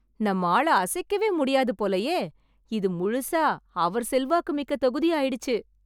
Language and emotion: Tamil, happy